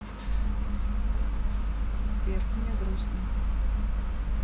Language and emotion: Russian, sad